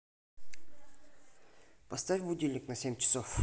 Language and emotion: Russian, neutral